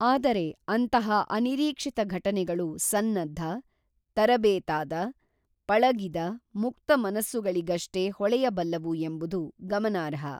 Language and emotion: Kannada, neutral